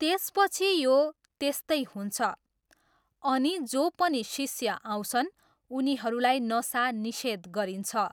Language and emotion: Nepali, neutral